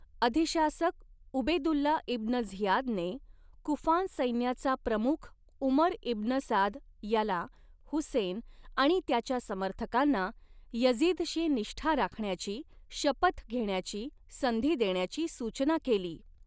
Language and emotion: Marathi, neutral